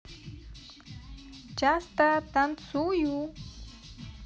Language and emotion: Russian, positive